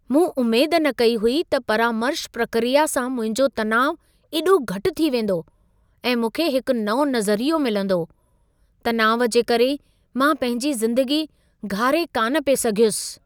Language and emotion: Sindhi, surprised